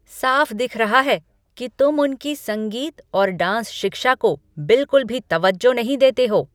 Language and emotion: Hindi, angry